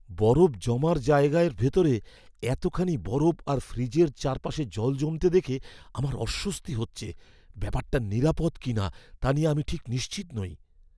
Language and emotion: Bengali, fearful